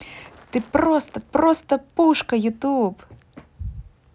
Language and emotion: Russian, positive